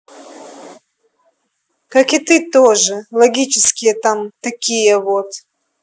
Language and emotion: Russian, angry